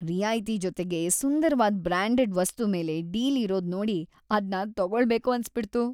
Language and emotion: Kannada, happy